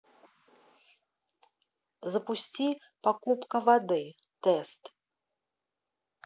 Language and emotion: Russian, neutral